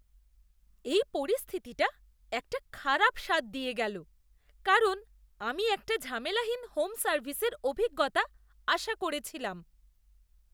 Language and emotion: Bengali, disgusted